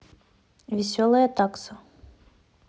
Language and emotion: Russian, neutral